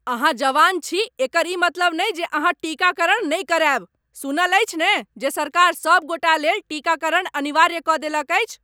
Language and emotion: Maithili, angry